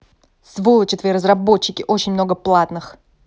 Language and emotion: Russian, angry